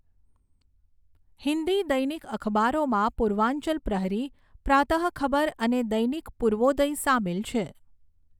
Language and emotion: Gujarati, neutral